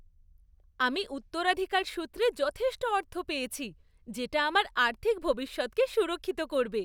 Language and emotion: Bengali, happy